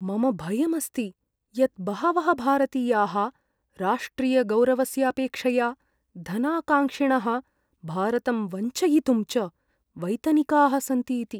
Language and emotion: Sanskrit, fearful